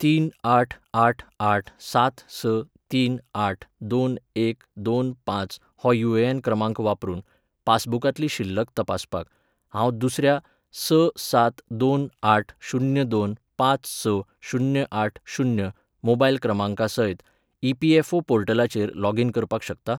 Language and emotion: Goan Konkani, neutral